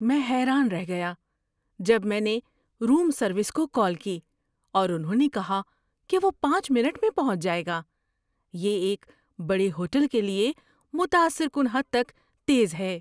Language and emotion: Urdu, surprised